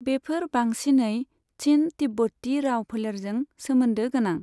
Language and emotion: Bodo, neutral